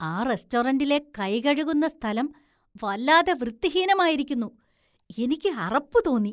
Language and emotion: Malayalam, disgusted